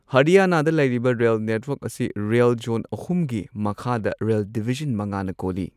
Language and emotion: Manipuri, neutral